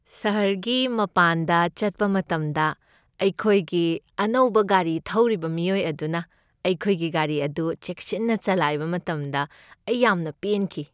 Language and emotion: Manipuri, happy